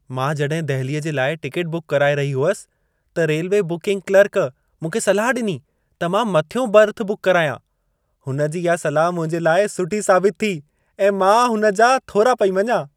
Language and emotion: Sindhi, happy